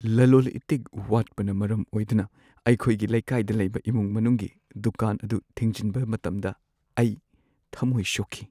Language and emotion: Manipuri, sad